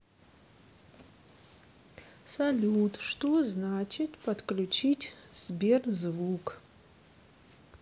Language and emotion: Russian, neutral